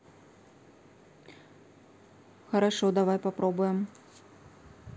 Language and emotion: Russian, neutral